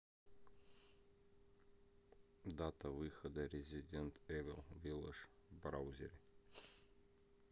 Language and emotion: Russian, neutral